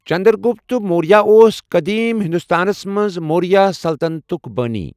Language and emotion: Kashmiri, neutral